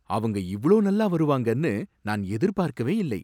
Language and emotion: Tamil, surprised